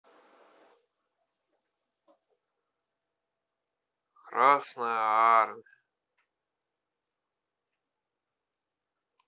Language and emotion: Russian, sad